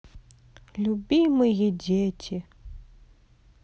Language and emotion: Russian, sad